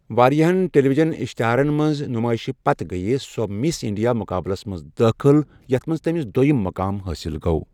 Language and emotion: Kashmiri, neutral